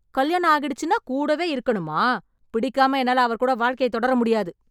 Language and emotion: Tamil, angry